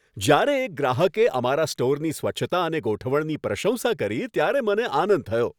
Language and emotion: Gujarati, happy